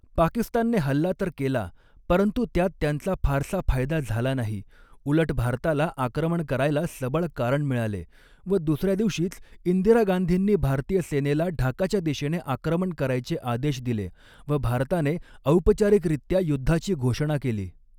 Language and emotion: Marathi, neutral